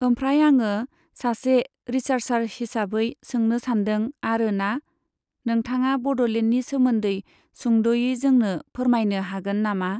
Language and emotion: Bodo, neutral